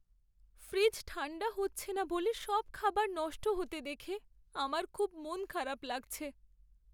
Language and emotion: Bengali, sad